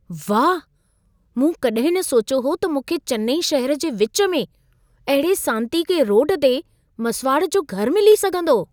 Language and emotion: Sindhi, surprised